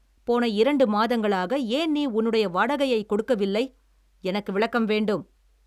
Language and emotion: Tamil, angry